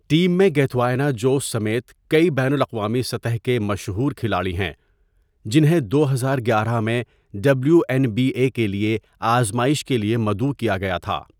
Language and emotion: Urdu, neutral